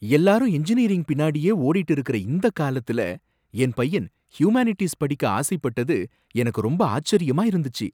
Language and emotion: Tamil, surprised